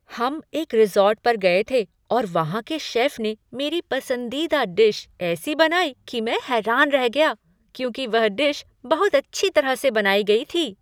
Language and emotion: Hindi, surprised